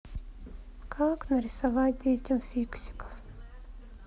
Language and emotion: Russian, sad